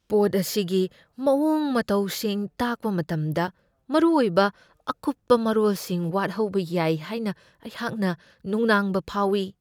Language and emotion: Manipuri, fearful